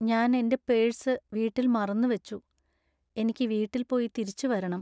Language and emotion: Malayalam, sad